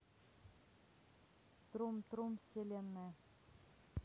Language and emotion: Russian, neutral